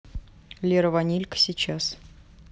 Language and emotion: Russian, neutral